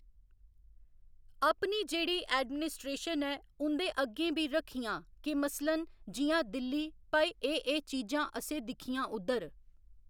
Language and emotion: Dogri, neutral